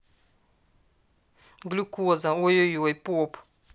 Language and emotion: Russian, neutral